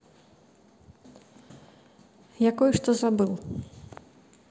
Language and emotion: Russian, neutral